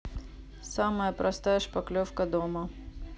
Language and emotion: Russian, neutral